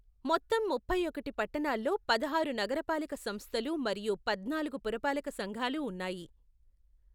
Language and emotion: Telugu, neutral